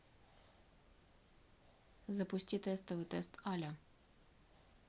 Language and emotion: Russian, neutral